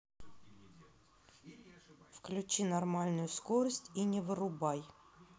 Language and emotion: Russian, angry